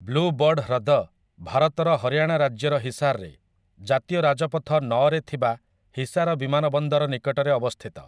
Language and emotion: Odia, neutral